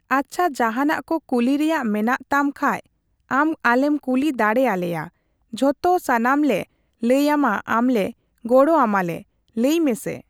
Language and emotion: Santali, neutral